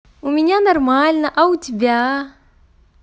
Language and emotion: Russian, positive